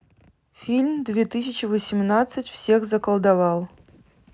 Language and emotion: Russian, neutral